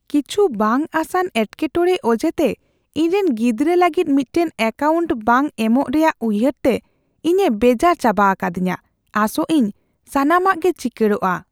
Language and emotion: Santali, fearful